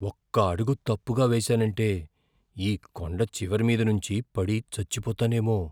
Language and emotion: Telugu, fearful